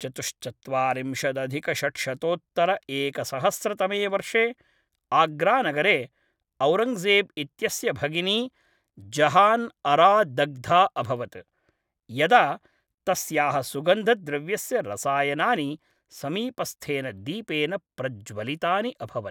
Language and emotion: Sanskrit, neutral